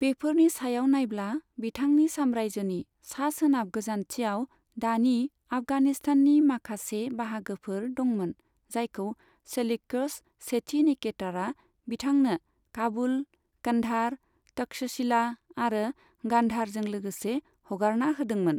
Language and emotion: Bodo, neutral